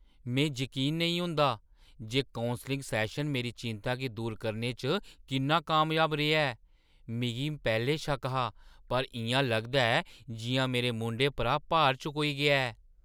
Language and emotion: Dogri, surprised